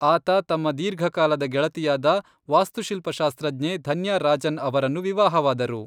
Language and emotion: Kannada, neutral